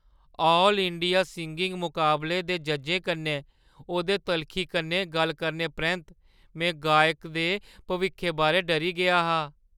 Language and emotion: Dogri, fearful